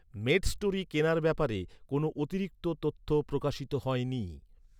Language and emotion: Bengali, neutral